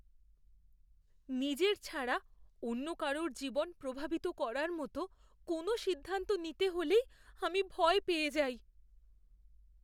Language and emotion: Bengali, fearful